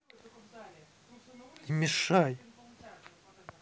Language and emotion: Russian, angry